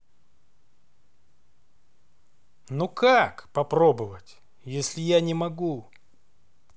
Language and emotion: Russian, neutral